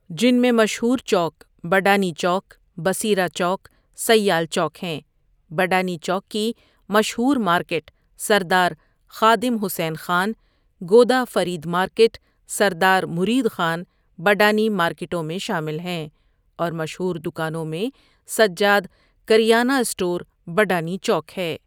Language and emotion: Urdu, neutral